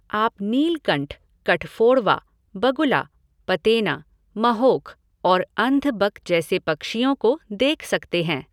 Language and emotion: Hindi, neutral